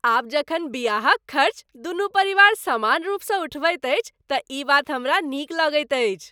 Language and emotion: Maithili, happy